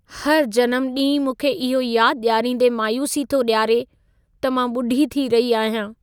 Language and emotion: Sindhi, sad